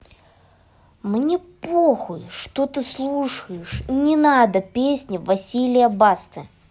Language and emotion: Russian, angry